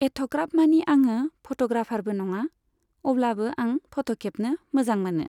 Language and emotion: Bodo, neutral